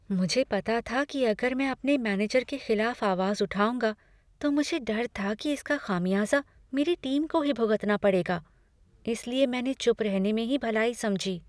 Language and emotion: Hindi, fearful